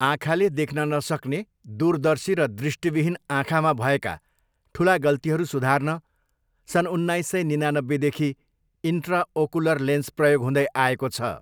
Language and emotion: Nepali, neutral